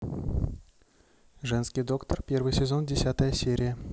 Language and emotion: Russian, neutral